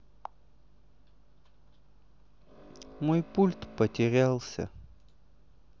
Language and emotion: Russian, sad